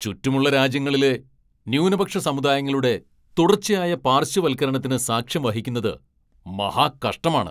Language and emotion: Malayalam, angry